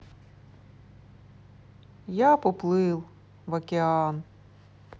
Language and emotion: Russian, neutral